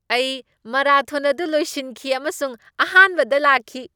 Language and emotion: Manipuri, happy